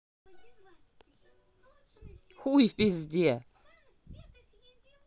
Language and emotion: Russian, angry